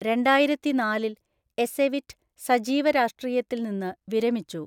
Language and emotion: Malayalam, neutral